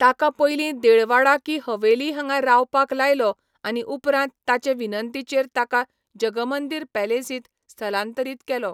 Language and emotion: Goan Konkani, neutral